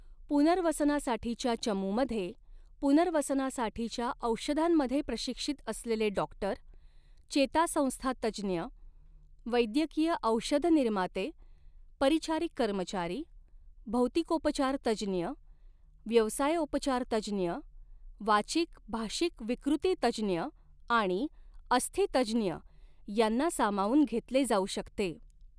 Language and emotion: Marathi, neutral